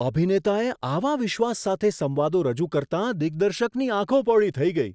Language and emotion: Gujarati, surprised